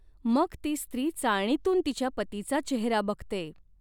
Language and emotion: Marathi, neutral